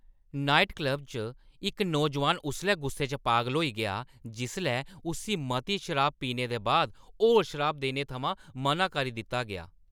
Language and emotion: Dogri, angry